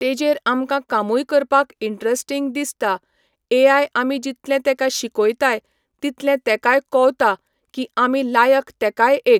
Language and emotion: Goan Konkani, neutral